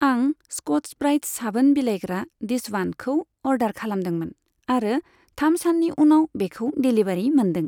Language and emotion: Bodo, neutral